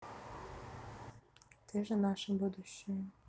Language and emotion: Russian, neutral